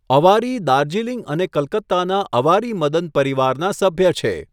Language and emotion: Gujarati, neutral